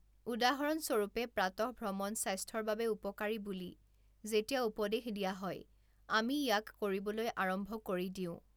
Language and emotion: Assamese, neutral